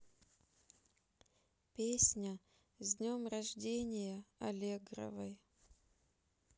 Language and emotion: Russian, neutral